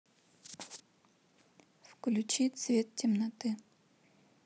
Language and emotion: Russian, neutral